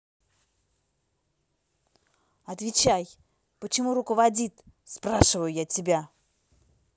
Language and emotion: Russian, angry